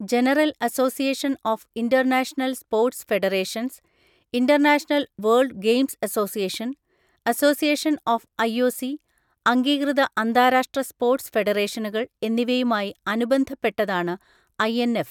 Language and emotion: Malayalam, neutral